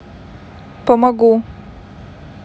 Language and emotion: Russian, neutral